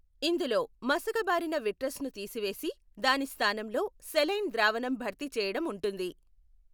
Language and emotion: Telugu, neutral